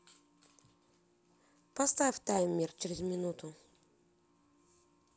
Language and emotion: Russian, neutral